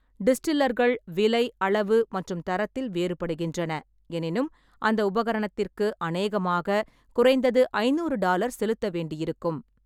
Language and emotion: Tamil, neutral